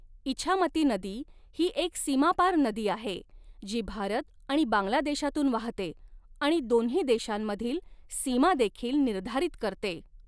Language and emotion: Marathi, neutral